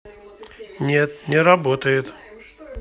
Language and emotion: Russian, neutral